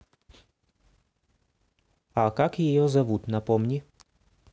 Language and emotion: Russian, neutral